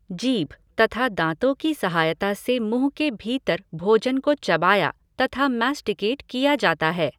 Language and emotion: Hindi, neutral